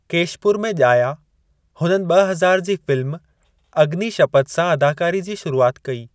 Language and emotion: Sindhi, neutral